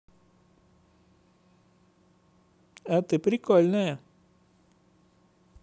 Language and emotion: Russian, positive